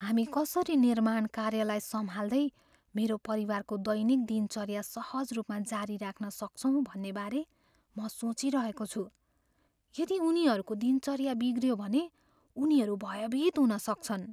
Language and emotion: Nepali, fearful